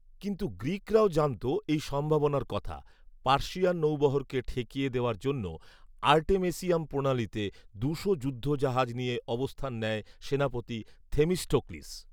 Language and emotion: Bengali, neutral